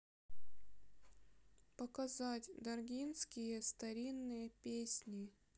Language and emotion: Russian, sad